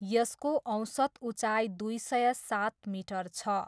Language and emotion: Nepali, neutral